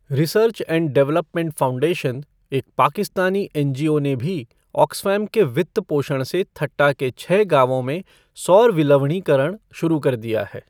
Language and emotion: Hindi, neutral